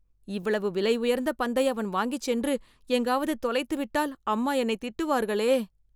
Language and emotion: Tamil, fearful